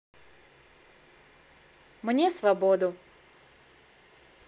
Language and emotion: Russian, neutral